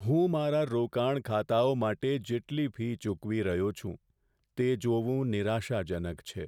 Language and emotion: Gujarati, sad